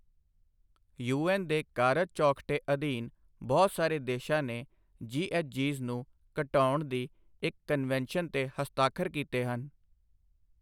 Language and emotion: Punjabi, neutral